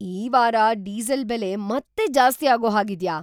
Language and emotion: Kannada, surprised